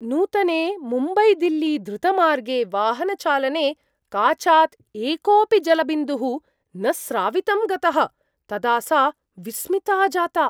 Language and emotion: Sanskrit, surprised